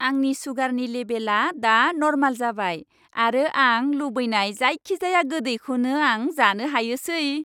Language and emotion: Bodo, happy